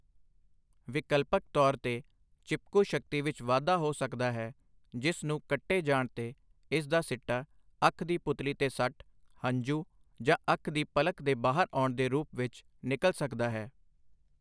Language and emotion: Punjabi, neutral